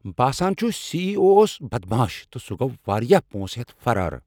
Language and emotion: Kashmiri, angry